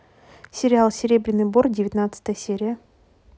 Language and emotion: Russian, neutral